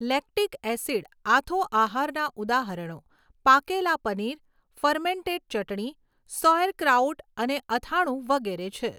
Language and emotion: Gujarati, neutral